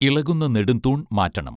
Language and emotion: Malayalam, neutral